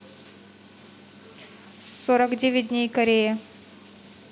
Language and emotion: Russian, neutral